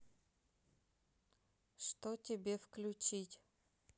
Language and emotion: Russian, neutral